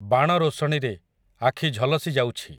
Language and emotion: Odia, neutral